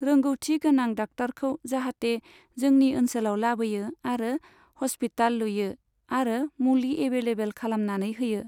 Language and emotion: Bodo, neutral